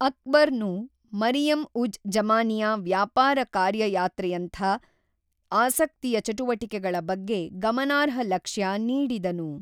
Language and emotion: Kannada, neutral